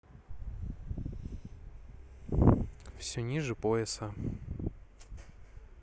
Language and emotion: Russian, neutral